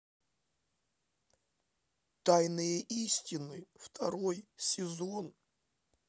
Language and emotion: Russian, neutral